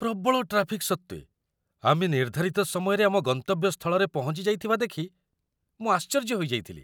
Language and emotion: Odia, surprised